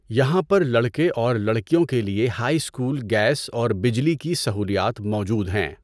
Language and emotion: Urdu, neutral